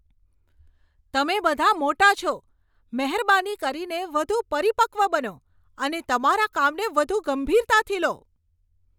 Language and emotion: Gujarati, angry